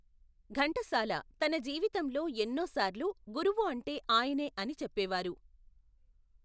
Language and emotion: Telugu, neutral